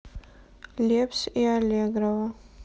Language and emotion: Russian, sad